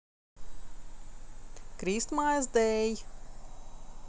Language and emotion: Russian, positive